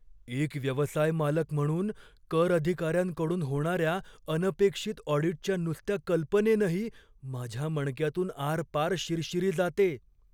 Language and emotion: Marathi, fearful